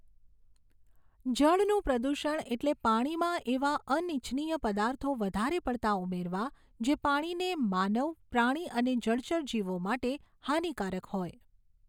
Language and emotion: Gujarati, neutral